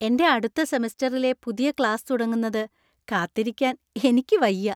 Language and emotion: Malayalam, happy